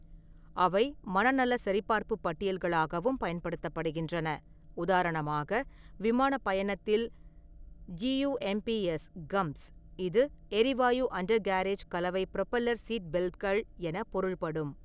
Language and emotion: Tamil, neutral